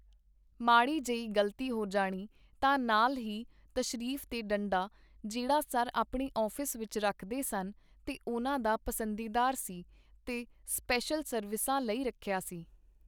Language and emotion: Punjabi, neutral